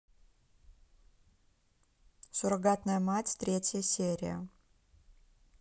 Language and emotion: Russian, neutral